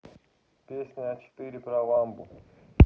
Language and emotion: Russian, neutral